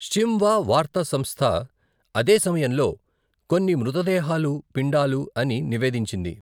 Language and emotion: Telugu, neutral